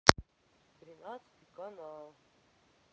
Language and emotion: Russian, neutral